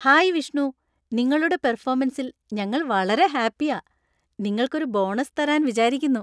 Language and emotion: Malayalam, happy